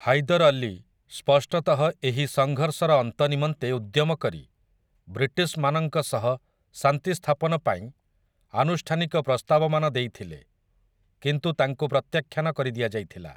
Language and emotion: Odia, neutral